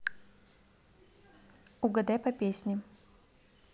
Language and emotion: Russian, neutral